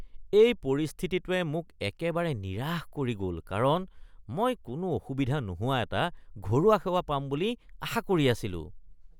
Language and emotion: Assamese, disgusted